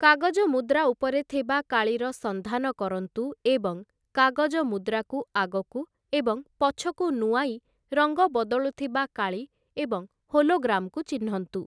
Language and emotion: Odia, neutral